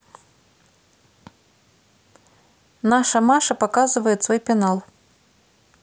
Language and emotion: Russian, neutral